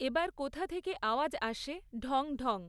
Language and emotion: Bengali, neutral